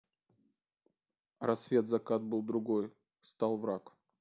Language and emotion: Russian, neutral